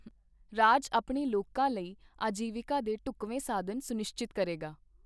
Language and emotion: Punjabi, neutral